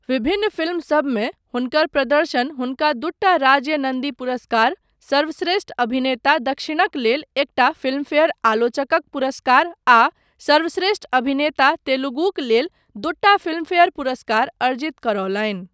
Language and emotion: Maithili, neutral